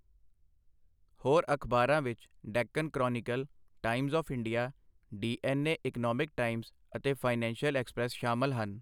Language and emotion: Punjabi, neutral